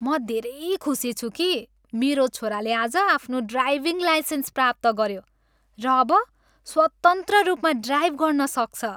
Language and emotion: Nepali, happy